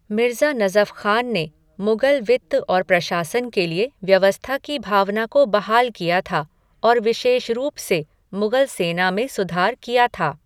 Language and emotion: Hindi, neutral